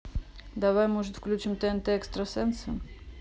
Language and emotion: Russian, neutral